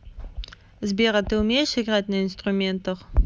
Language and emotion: Russian, neutral